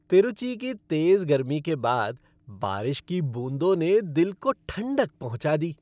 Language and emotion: Hindi, happy